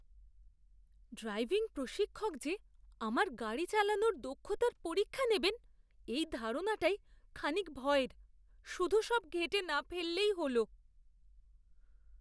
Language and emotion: Bengali, fearful